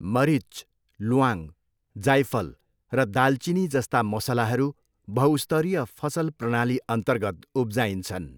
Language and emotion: Nepali, neutral